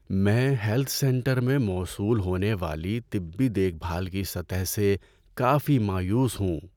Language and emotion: Urdu, sad